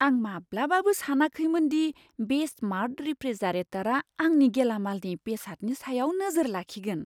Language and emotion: Bodo, surprised